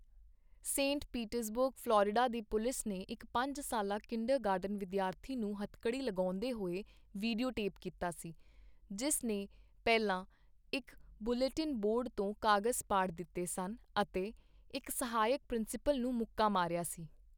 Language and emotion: Punjabi, neutral